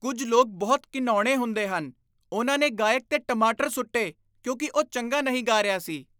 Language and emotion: Punjabi, disgusted